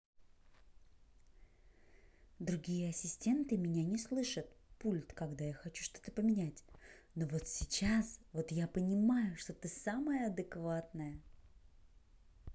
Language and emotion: Russian, neutral